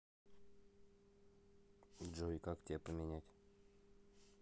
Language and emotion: Russian, neutral